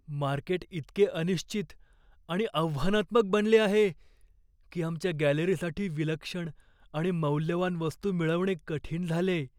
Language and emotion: Marathi, fearful